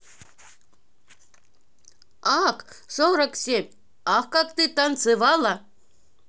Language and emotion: Russian, positive